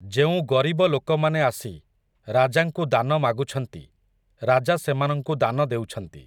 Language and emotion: Odia, neutral